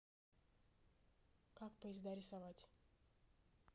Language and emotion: Russian, neutral